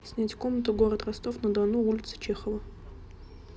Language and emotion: Russian, neutral